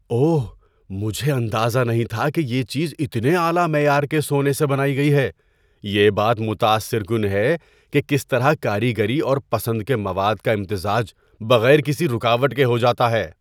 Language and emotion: Urdu, surprised